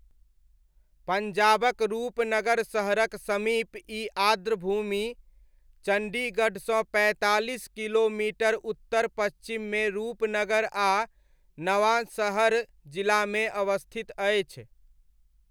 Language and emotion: Maithili, neutral